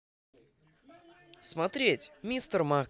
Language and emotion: Russian, positive